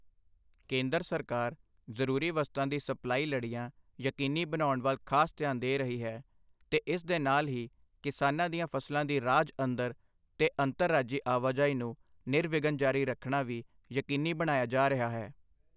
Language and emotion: Punjabi, neutral